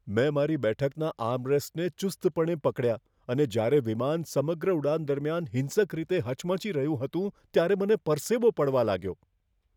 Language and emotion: Gujarati, fearful